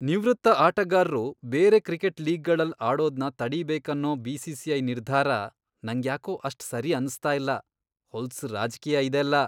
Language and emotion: Kannada, disgusted